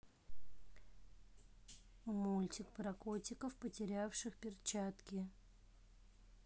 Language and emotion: Russian, neutral